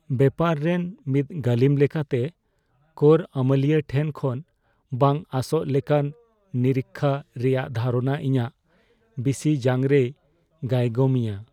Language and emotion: Santali, fearful